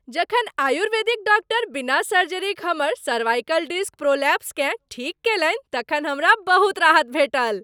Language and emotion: Maithili, happy